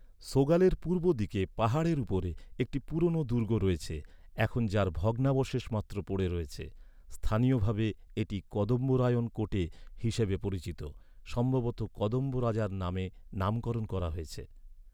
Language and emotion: Bengali, neutral